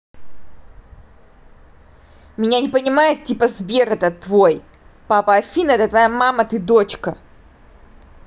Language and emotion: Russian, angry